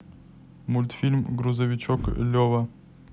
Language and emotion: Russian, neutral